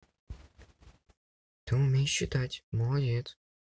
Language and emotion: Russian, neutral